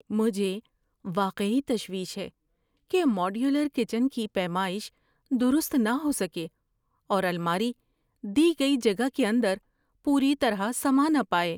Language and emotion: Urdu, fearful